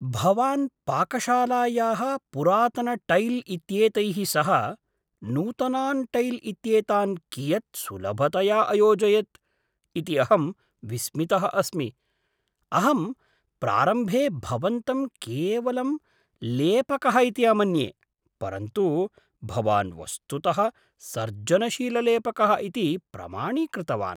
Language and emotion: Sanskrit, surprised